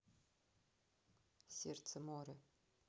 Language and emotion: Russian, neutral